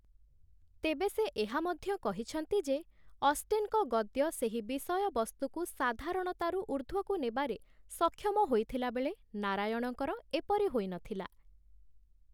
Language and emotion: Odia, neutral